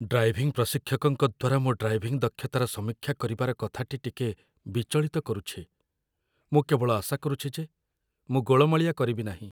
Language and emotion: Odia, fearful